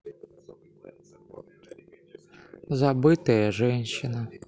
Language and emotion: Russian, sad